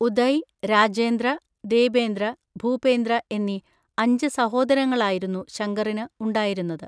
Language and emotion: Malayalam, neutral